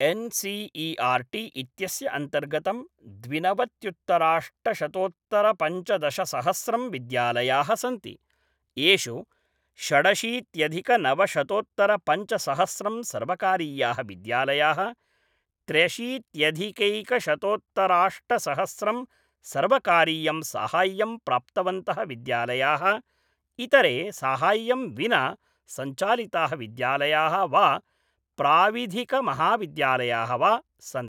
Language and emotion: Sanskrit, neutral